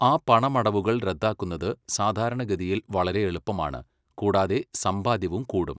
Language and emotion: Malayalam, neutral